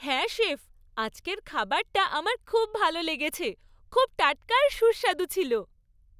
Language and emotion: Bengali, happy